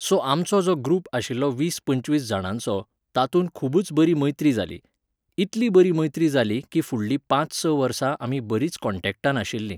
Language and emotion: Goan Konkani, neutral